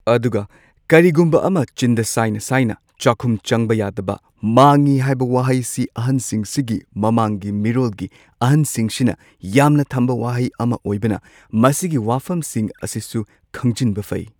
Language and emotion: Manipuri, neutral